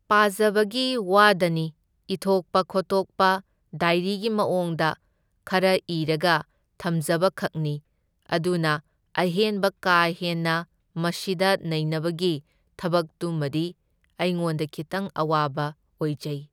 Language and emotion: Manipuri, neutral